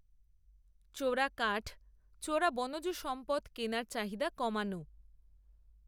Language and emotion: Bengali, neutral